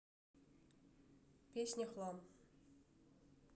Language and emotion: Russian, neutral